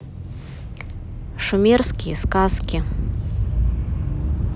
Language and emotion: Russian, neutral